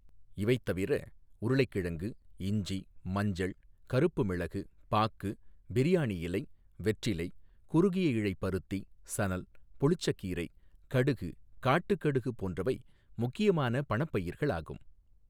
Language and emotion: Tamil, neutral